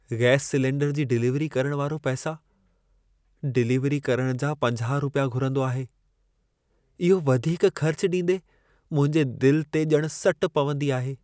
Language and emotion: Sindhi, sad